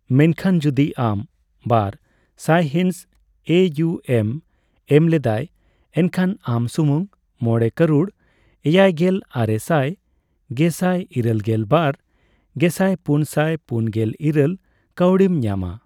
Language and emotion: Santali, neutral